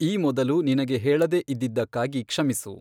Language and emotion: Kannada, neutral